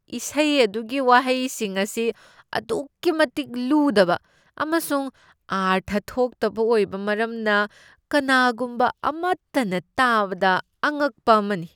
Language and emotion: Manipuri, disgusted